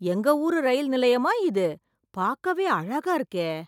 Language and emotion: Tamil, surprised